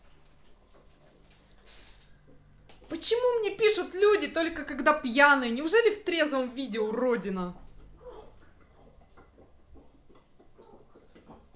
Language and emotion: Russian, angry